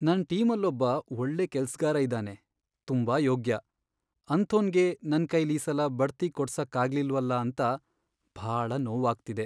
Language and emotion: Kannada, sad